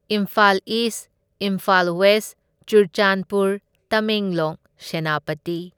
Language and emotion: Manipuri, neutral